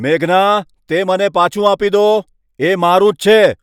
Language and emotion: Gujarati, angry